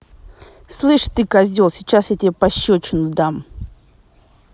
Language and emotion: Russian, angry